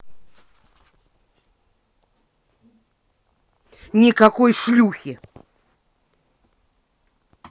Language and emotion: Russian, angry